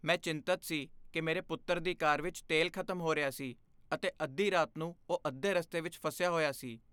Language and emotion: Punjabi, fearful